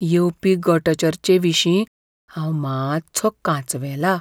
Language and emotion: Goan Konkani, fearful